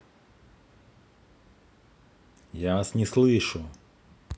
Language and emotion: Russian, angry